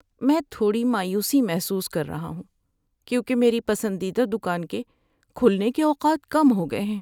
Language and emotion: Urdu, sad